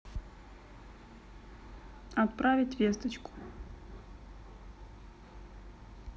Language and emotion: Russian, neutral